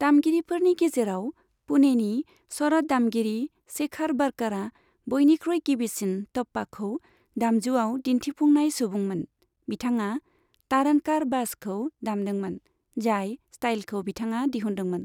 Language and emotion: Bodo, neutral